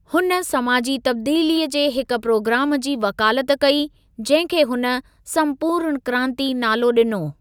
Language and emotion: Sindhi, neutral